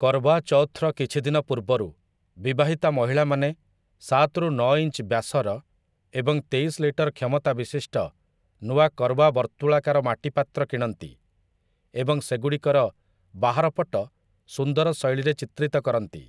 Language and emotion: Odia, neutral